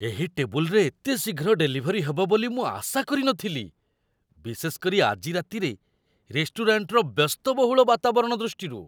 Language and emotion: Odia, surprised